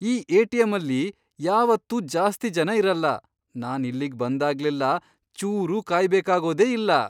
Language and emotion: Kannada, surprised